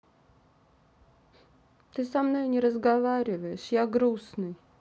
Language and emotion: Russian, sad